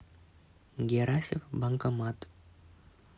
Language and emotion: Russian, neutral